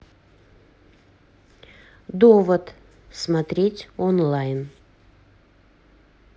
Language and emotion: Russian, neutral